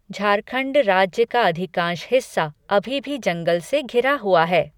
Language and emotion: Hindi, neutral